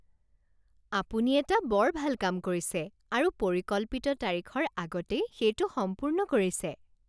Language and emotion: Assamese, happy